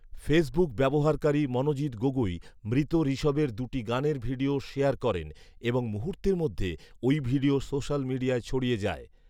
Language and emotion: Bengali, neutral